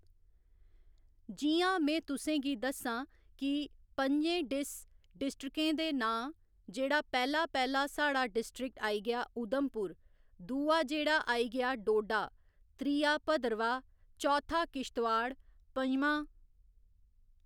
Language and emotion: Dogri, neutral